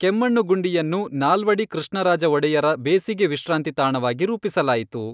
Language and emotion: Kannada, neutral